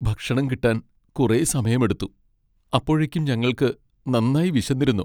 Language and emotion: Malayalam, sad